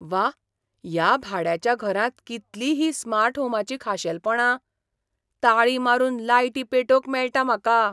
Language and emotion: Goan Konkani, surprised